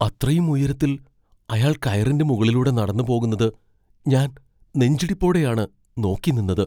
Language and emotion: Malayalam, fearful